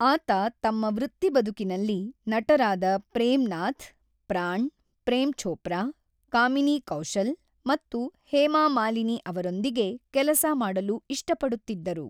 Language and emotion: Kannada, neutral